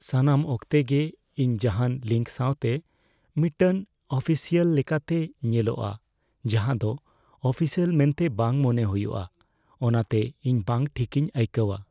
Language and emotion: Santali, fearful